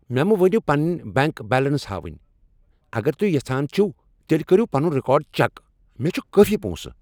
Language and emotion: Kashmiri, angry